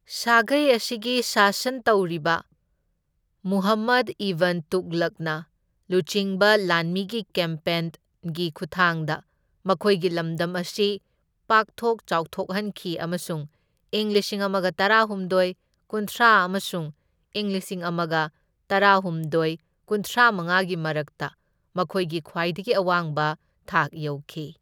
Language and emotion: Manipuri, neutral